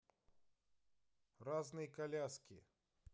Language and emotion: Russian, neutral